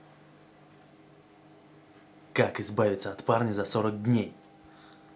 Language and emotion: Russian, angry